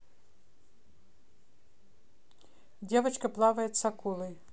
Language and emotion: Russian, neutral